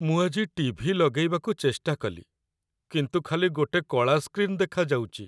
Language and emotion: Odia, sad